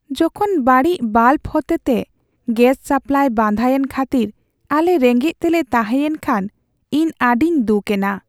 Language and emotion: Santali, sad